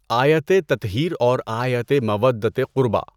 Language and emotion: Urdu, neutral